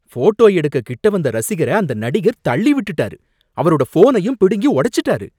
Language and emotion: Tamil, angry